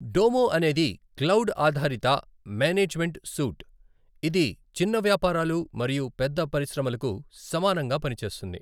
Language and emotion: Telugu, neutral